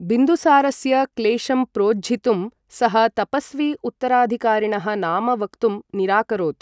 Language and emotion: Sanskrit, neutral